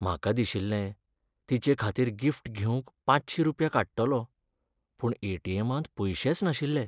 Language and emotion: Goan Konkani, sad